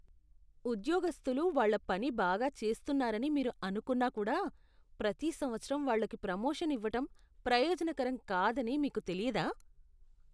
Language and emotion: Telugu, disgusted